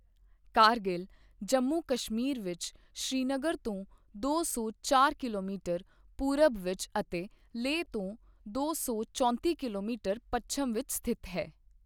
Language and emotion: Punjabi, neutral